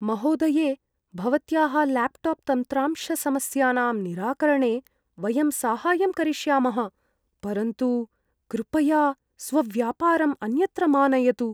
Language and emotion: Sanskrit, fearful